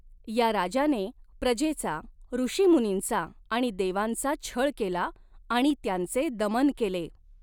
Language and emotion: Marathi, neutral